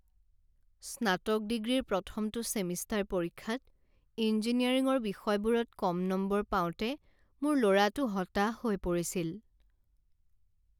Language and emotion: Assamese, sad